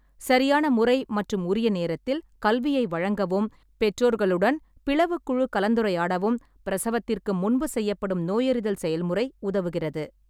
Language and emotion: Tamil, neutral